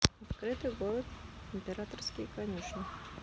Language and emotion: Russian, neutral